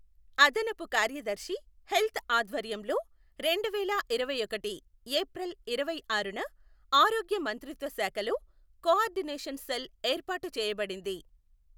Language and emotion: Telugu, neutral